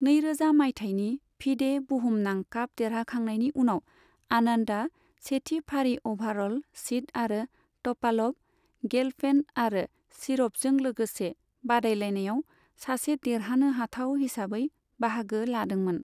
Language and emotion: Bodo, neutral